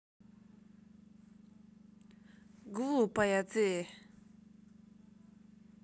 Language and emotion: Russian, angry